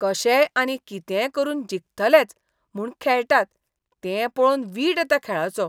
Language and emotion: Goan Konkani, disgusted